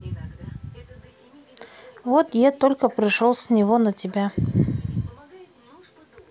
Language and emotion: Russian, neutral